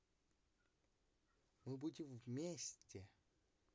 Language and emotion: Russian, positive